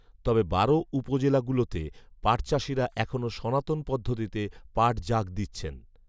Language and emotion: Bengali, neutral